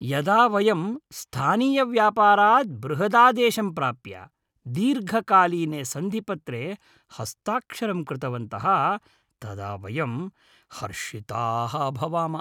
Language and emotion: Sanskrit, happy